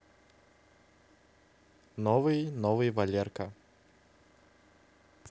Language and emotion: Russian, neutral